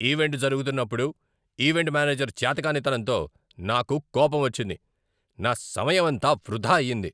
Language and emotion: Telugu, angry